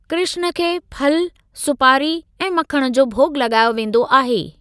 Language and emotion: Sindhi, neutral